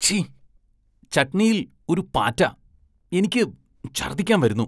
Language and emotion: Malayalam, disgusted